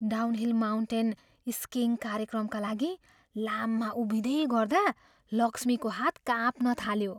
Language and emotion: Nepali, fearful